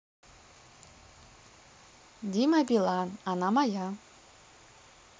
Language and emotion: Russian, neutral